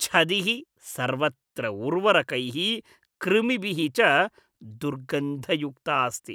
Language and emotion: Sanskrit, disgusted